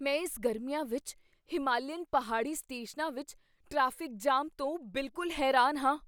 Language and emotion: Punjabi, surprised